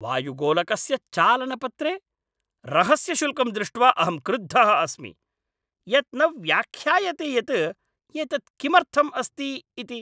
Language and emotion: Sanskrit, angry